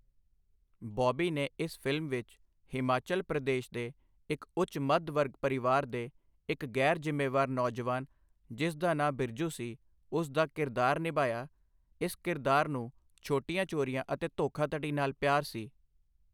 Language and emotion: Punjabi, neutral